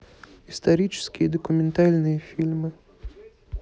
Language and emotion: Russian, neutral